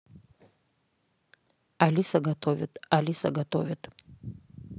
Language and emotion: Russian, neutral